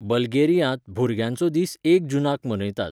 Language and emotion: Goan Konkani, neutral